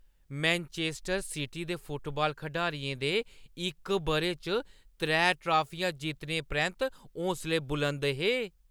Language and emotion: Dogri, happy